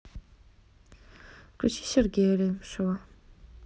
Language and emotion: Russian, neutral